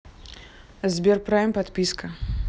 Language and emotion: Russian, neutral